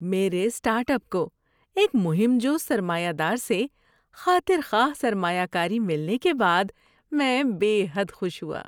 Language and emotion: Urdu, happy